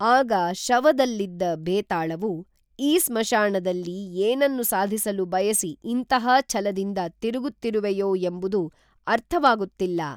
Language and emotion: Kannada, neutral